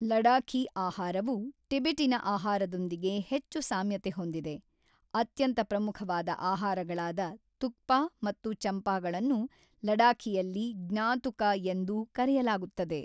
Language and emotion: Kannada, neutral